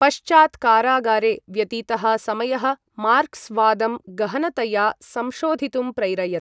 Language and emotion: Sanskrit, neutral